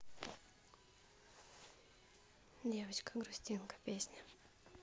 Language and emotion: Russian, neutral